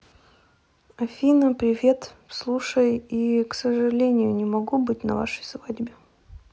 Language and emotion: Russian, sad